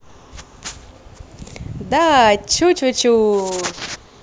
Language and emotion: Russian, positive